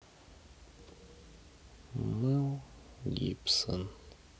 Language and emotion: Russian, sad